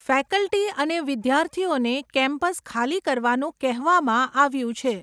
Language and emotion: Gujarati, neutral